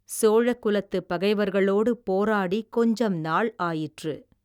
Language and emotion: Tamil, neutral